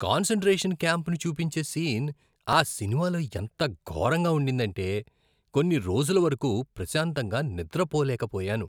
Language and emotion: Telugu, disgusted